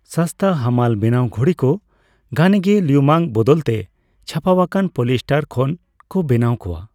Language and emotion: Santali, neutral